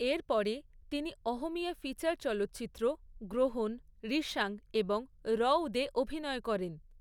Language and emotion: Bengali, neutral